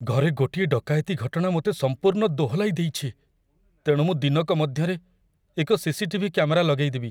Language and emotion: Odia, fearful